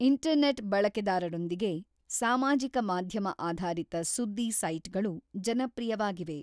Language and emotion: Kannada, neutral